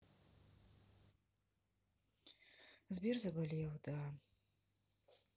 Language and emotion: Russian, sad